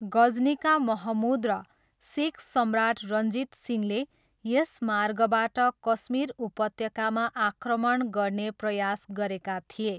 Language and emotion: Nepali, neutral